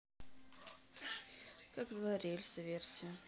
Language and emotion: Russian, neutral